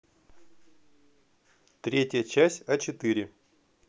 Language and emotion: Russian, neutral